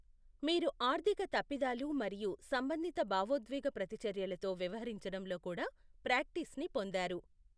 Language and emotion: Telugu, neutral